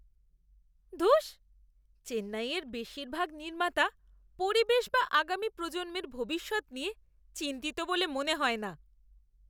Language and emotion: Bengali, disgusted